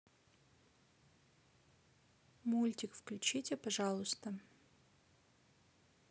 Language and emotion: Russian, neutral